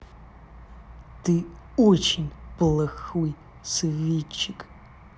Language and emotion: Russian, angry